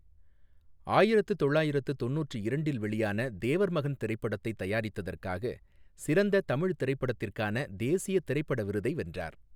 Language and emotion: Tamil, neutral